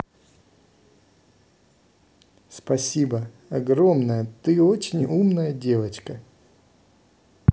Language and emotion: Russian, positive